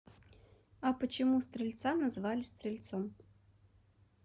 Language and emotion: Russian, neutral